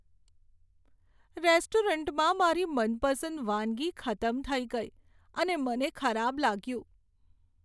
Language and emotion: Gujarati, sad